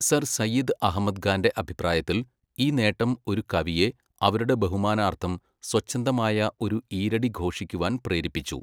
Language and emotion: Malayalam, neutral